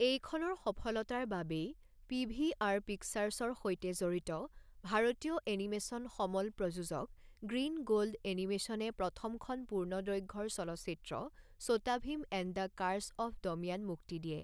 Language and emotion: Assamese, neutral